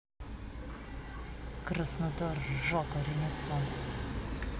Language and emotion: Russian, angry